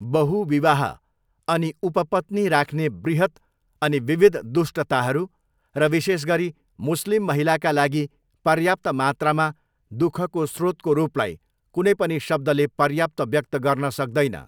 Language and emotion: Nepali, neutral